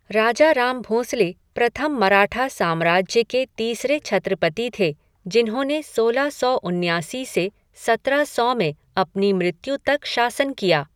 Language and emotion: Hindi, neutral